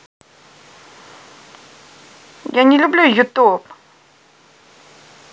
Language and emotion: Russian, angry